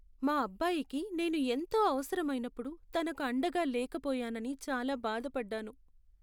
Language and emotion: Telugu, sad